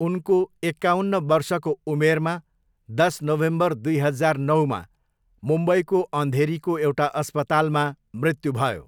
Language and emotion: Nepali, neutral